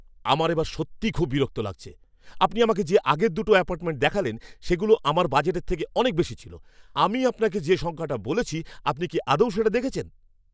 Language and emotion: Bengali, angry